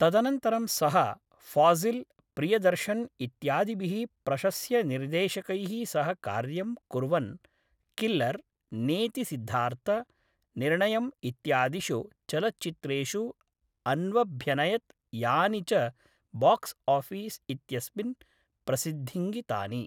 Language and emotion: Sanskrit, neutral